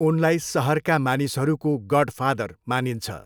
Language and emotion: Nepali, neutral